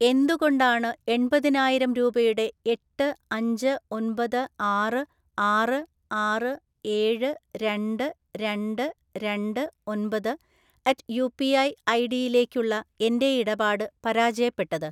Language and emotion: Malayalam, neutral